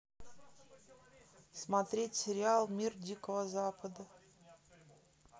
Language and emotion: Russian, neutral